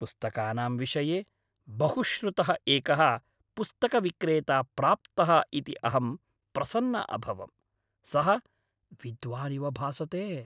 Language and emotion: Sanskrit, happy